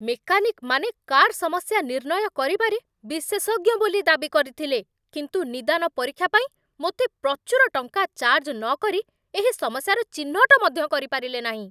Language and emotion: Odia, angry